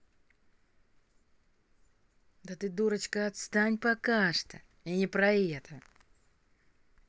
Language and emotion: Russian, angry